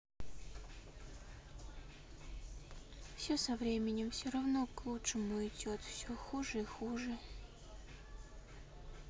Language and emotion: Russian, sad